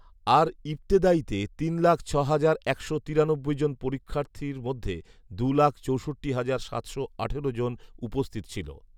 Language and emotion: Bengali, neutral